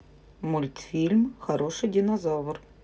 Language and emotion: Russian, neutral